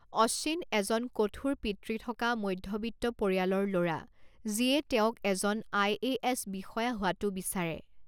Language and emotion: Assamese, neutral